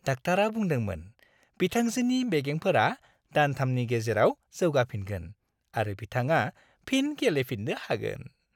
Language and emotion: Bodo, happy